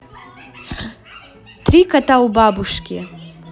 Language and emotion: Russian, positive